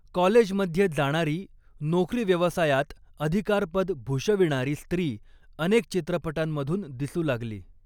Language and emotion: Marathi, neutral